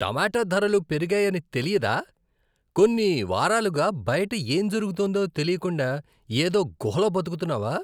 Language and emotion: Telugu, disgusted